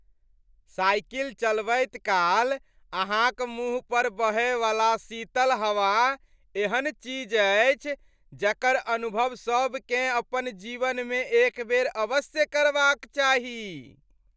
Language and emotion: Maithili, happy